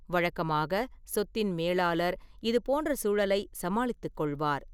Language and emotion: Tamil, neutral